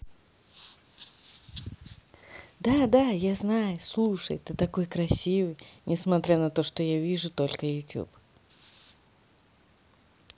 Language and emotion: Russian, positive